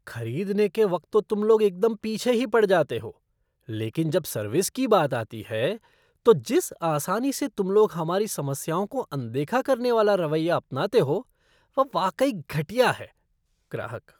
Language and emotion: Hindi, disgusted